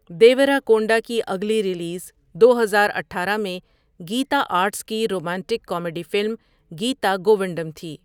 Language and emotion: Urdu, neutral